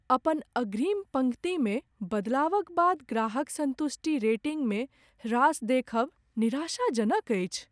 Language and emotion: Maithili, sad